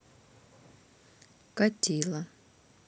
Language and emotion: Russian, neutral